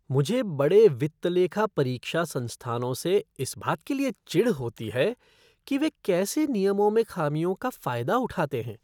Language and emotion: Hindi, disgusted